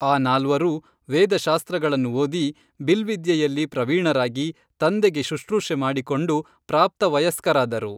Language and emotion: Kannada, neutral